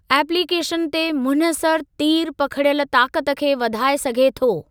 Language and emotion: Sindhi, neutral